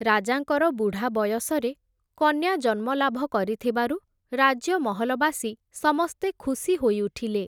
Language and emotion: Odia, neutral